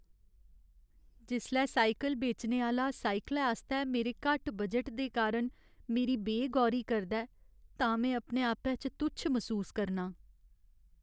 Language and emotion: Dogri, sad